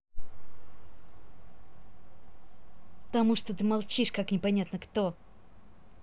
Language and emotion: Russian, angry